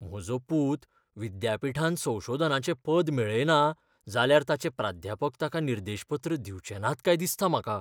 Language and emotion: Goan Konkani, fearful